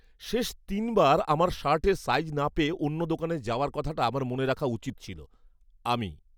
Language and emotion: Bengali, angry